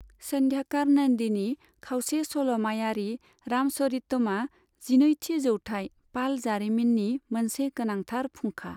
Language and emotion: Bodo, neutral